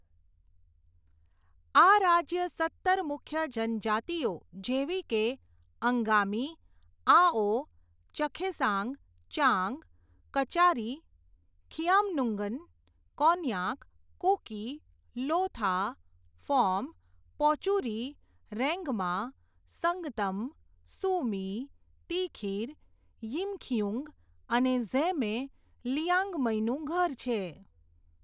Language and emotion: Gujarati, neutral